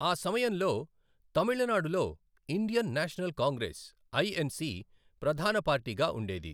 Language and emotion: Telugu, neutral